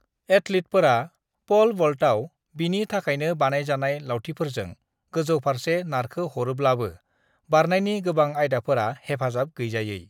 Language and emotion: Bodo, neutral